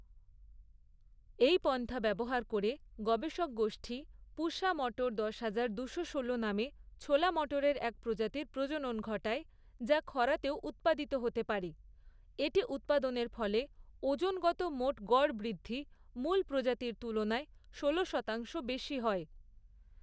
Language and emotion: Bengali, neutral